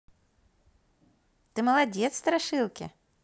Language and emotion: Russian, positive